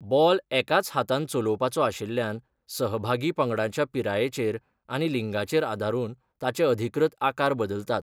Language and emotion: Goan Konkani, neutral